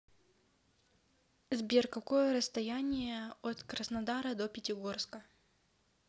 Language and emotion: Russian, neutral